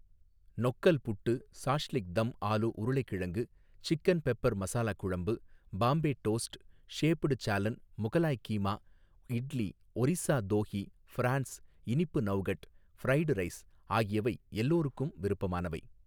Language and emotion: Tamil, neutral